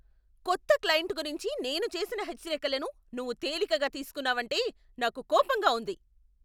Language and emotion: Telugu, angry